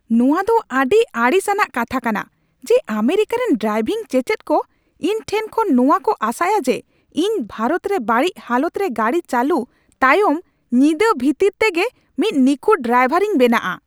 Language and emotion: Santali, angry